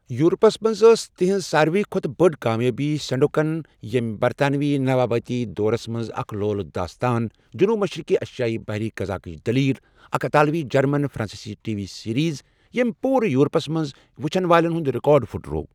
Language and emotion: Kashmiri, neutral